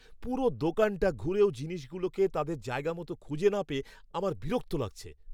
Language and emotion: Bengali, angry